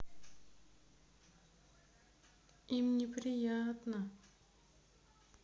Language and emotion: Russian, sad